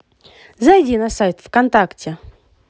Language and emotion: Russian, positive